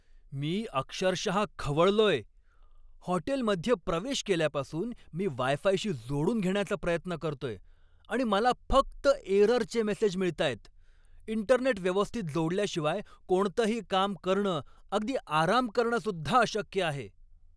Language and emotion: Marathi, angry